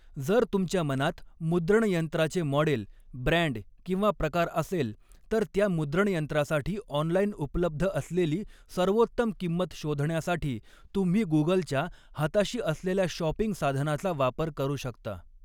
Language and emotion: Marathi, neutral